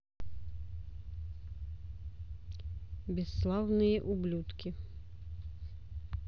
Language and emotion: Russian, neutral